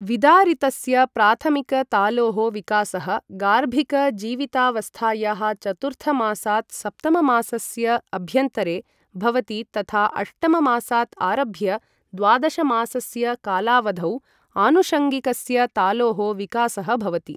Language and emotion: Sanskrit, neutral